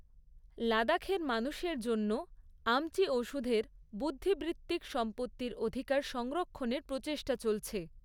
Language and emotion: Bengali, neutral